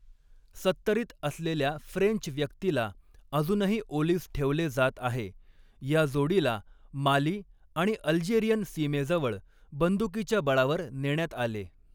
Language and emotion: Marathi, neutral